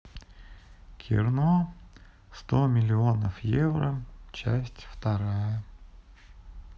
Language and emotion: Russian, sad